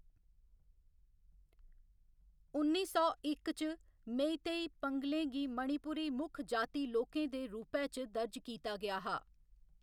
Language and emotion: Dogri, neutral